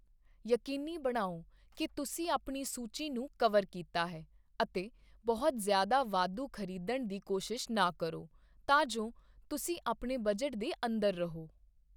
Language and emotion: Punjabi, neutral